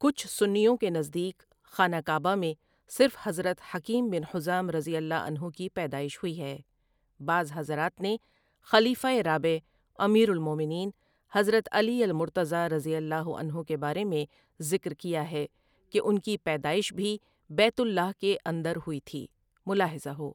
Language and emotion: Urdu, neutral